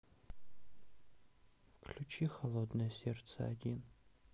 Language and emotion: Russian, sad